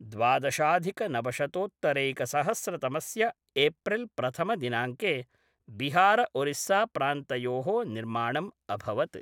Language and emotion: Sanskrit, neutral